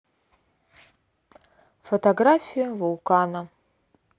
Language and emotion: Russian, neutral